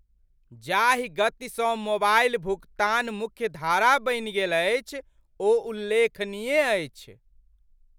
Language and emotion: Maithili, surprised